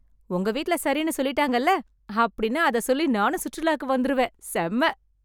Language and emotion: Tamil, happy